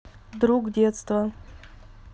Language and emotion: Russian, neutral